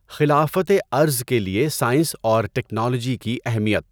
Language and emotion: Urdu, neutral